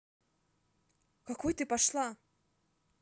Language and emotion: Russian, angry